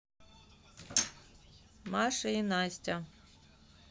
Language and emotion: Russian, neutral